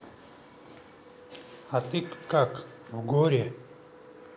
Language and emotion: Russian, neutral